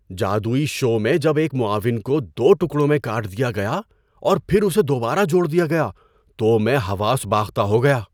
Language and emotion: Urdu, surprised